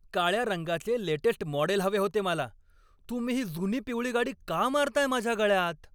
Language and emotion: Marathi, angry